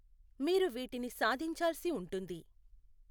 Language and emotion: Telugu, neutral